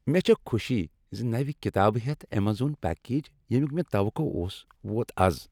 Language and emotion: Kashmiri, happy